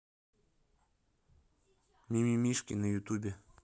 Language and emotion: Russian, neutral